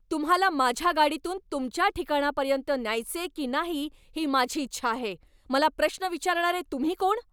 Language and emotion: Marathi, angry